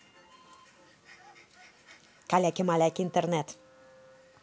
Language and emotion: Russian, angry